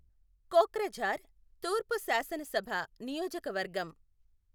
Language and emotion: Telugu, neutral